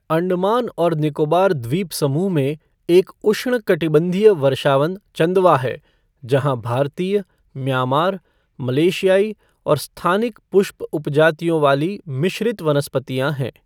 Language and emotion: Hindi, neutral